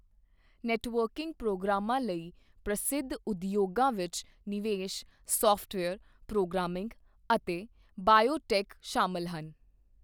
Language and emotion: Punjabi, neutral